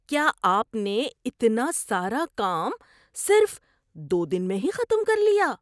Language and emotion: Urdu, surprised